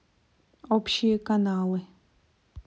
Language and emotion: Russian, neutral